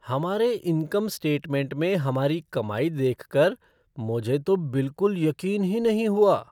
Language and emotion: Hindi, surprised